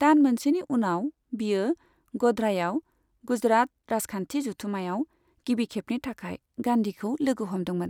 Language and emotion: Bodo, neutral